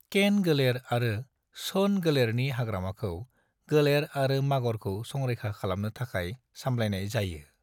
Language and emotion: Bodo, neutral